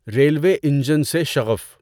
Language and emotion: Urdu, neutral